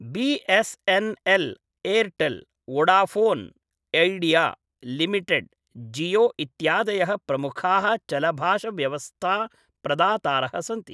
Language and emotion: Sanskrit, neutral